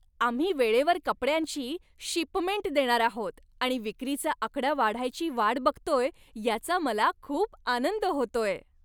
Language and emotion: Marathi, happy